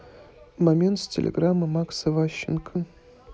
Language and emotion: Russian, neutral